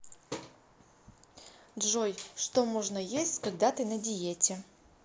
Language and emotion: Russian, neutral